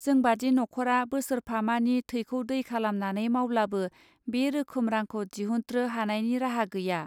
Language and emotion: Bodo, neutral